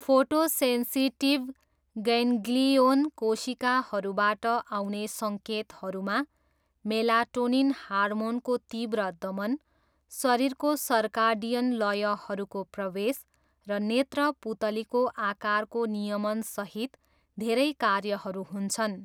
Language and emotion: Nepali, neutral